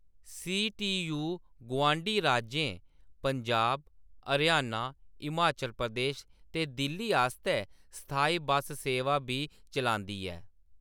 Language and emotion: Dogri, neutral